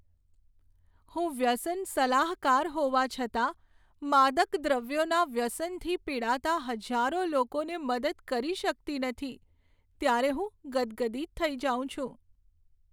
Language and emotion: Gujarati, sad